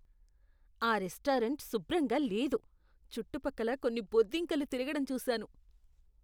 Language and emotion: Telugu, disgusted